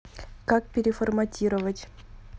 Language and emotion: Russian, neutral